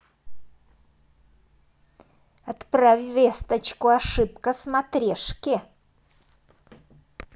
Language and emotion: Russian, angry